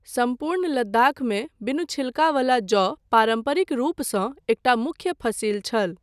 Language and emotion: Maithili, neutral